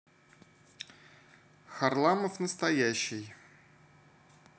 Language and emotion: Russian, neutral